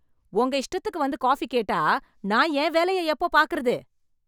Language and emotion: Tamil, angry